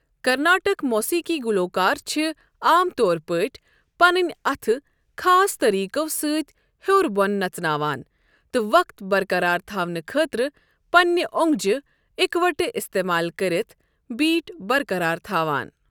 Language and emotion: Kashmiri, neutral